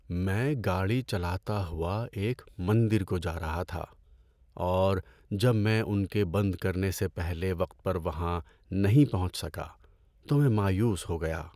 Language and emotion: Urdu, sad